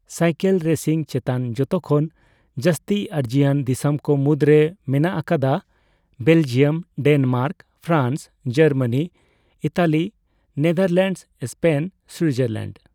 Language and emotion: Santali, neutral